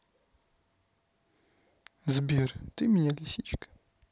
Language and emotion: Russian, neutral